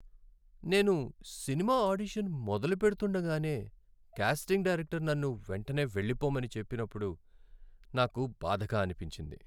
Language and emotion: Telugu, sad